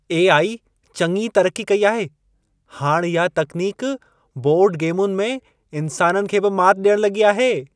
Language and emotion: Sindhi, happy